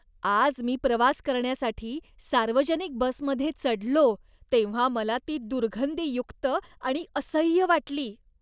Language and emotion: Marathi, disgusted